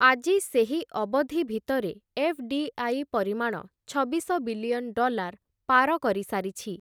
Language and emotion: Odia, neutral